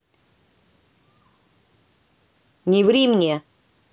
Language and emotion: Russian, angry